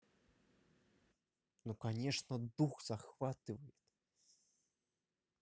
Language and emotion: Russian, neutral